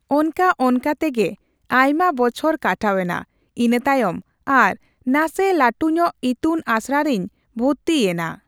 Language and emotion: Santali, neutral